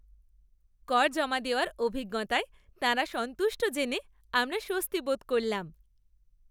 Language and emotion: Bengali, happy